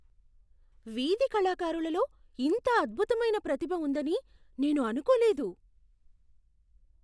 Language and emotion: Telugu, surprised